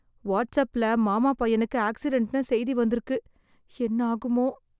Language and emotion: Tamil, fearful